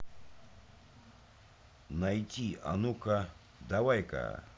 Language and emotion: Russian, neutral